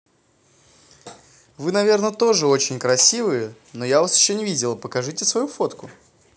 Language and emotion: Russian, positive